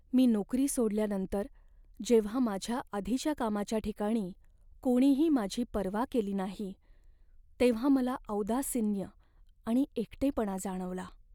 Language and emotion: Marathi, sad